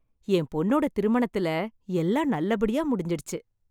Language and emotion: Tamil, happy